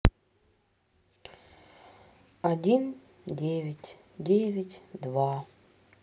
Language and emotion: Russian, sad